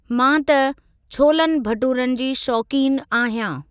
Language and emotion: Sindhi, neutral